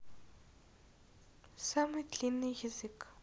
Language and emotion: Russian, neutral